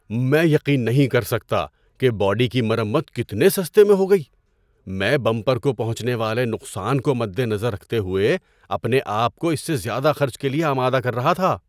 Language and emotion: Urdu, surprised